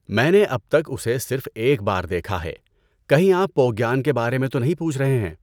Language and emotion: Urdu, neutral